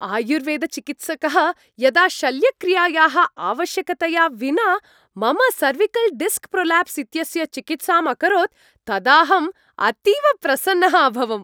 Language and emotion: Sanskrit, happy